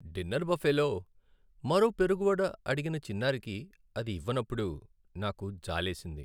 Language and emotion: Telugu, sad